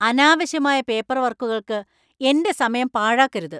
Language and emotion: Malayalam, angry